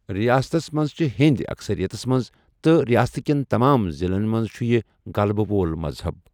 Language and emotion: Kashmiri, neutral